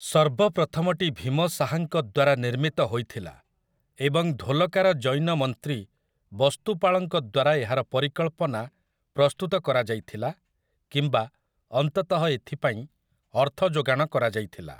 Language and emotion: Odia, neutral